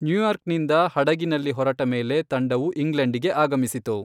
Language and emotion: Kannada, neutral